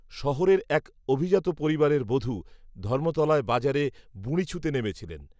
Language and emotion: Bengali, neutral